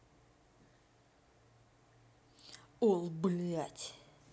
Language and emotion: Russian, angry